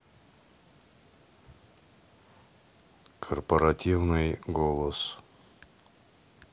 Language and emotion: Russian, neutral